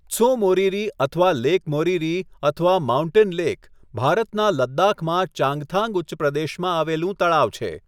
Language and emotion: Gujarati, neutral